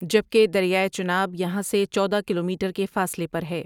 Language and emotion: Urdu, neutral